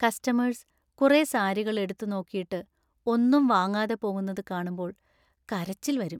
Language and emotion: Malayalam, sad